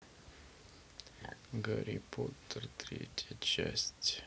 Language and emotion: Russian, sad